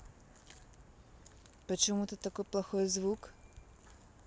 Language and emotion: Russian, neutral